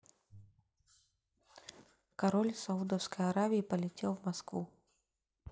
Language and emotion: Russian, neutral